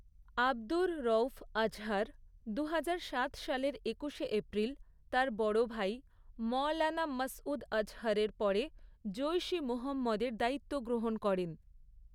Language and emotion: Bengali, neutral